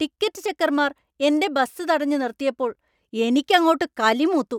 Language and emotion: Malayalam, angry